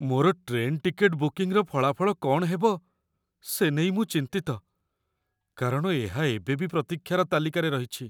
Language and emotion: Odia, fearful